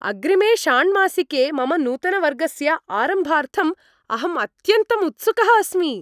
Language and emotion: Sanskrit, happy